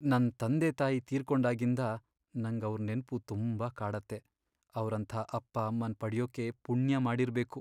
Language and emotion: Kannada, sad